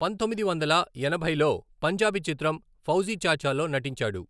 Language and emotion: Telugu, neutral